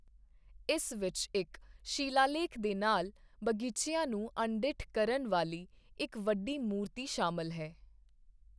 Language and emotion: Punjabi, neutral